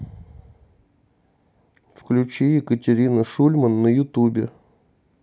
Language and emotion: Russian, neutral